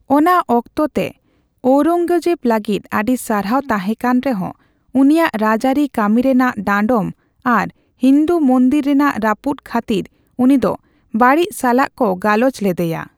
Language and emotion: Santali, neutral